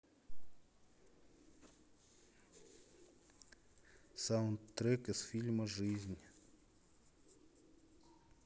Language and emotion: Russian, neutral